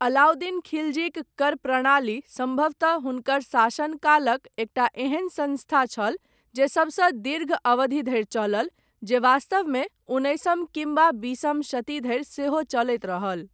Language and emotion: Maithili, neutral